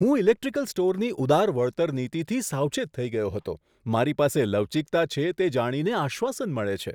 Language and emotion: Gujarati, surprised